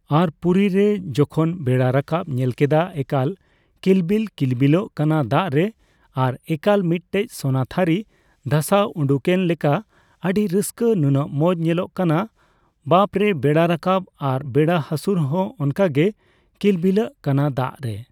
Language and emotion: Santali, neutral